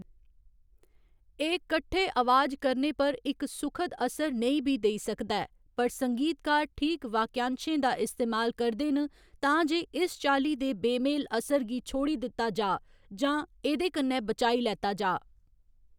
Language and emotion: Dogri, neutral